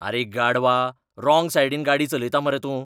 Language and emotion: Goan Konkani, angry